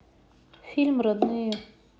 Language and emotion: Russian, neutral